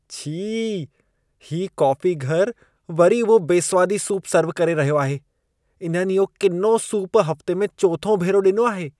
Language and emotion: Sindhi, disgusted